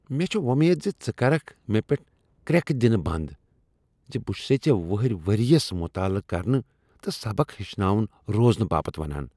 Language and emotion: Kashmiri, disgusted